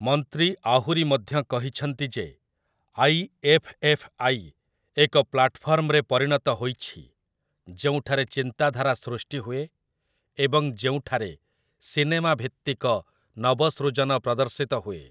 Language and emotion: Odia, neutral